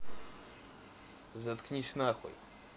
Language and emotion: Russian, neutral